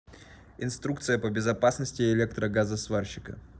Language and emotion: Russian, neutral